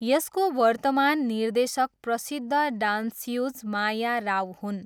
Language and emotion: Nepali, neutral